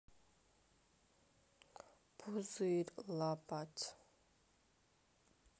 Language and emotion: Russian, sad